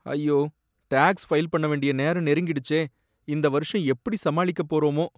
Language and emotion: Tamil, sad